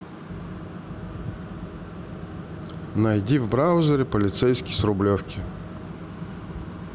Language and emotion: Russian, neutral